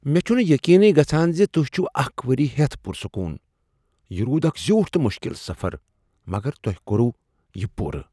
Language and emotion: Kashmiri, surprised